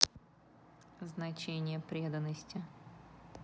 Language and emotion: Russian, neutral